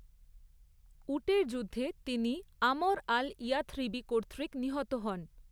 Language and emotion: Bengali, neutral